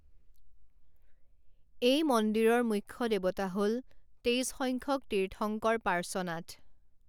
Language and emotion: Assamese, neutral